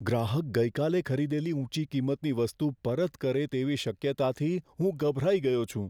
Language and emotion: Gujarati, fearful